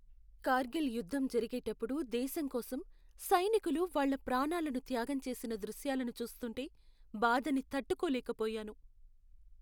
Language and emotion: Telugu, sad